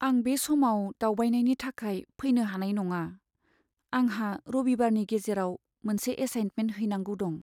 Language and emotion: Bodo, sad